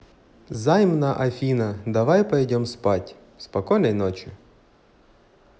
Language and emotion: Russian, positive